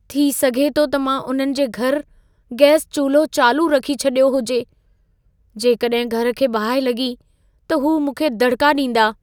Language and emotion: Sindhi, fearful